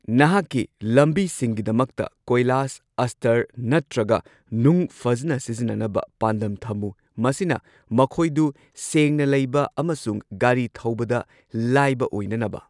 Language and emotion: Manipuri, neutral